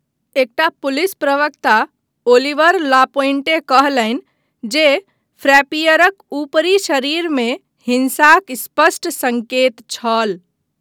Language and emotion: Maithili, neutral